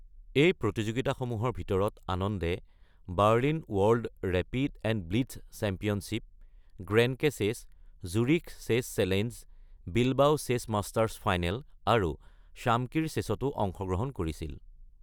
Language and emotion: Assamese, neutral